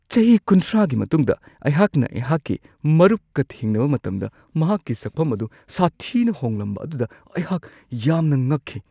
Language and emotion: Manipuri, surprised